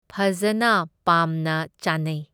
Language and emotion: Manipuri, neutral